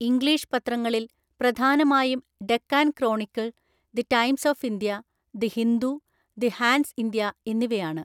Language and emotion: Malayalam, neutral